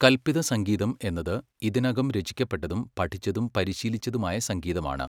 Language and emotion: Malayalam, neutral